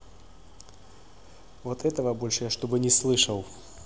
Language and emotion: Russian, angry